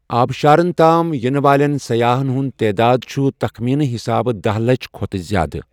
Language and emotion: Kashmiri, neutral